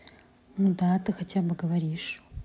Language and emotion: Russian, neutral